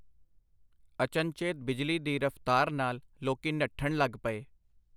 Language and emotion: Punjabi, neutral